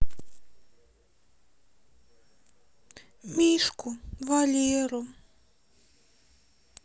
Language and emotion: Russian, sad